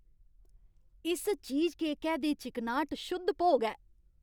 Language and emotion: Dogri, happy